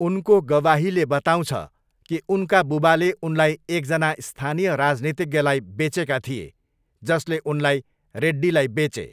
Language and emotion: Nepali, neutral